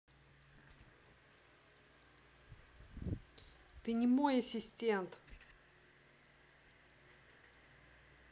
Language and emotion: Russian, angry